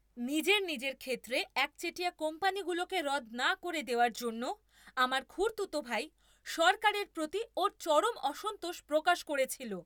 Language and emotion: Bengali, angry